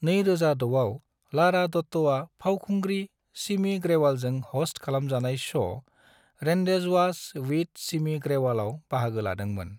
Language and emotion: Bodo, neutral